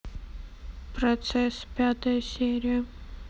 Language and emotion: Russian, neutral